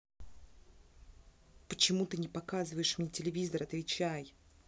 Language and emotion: Russian, angry